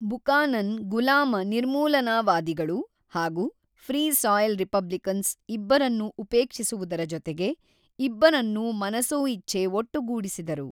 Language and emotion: Kannada, neutral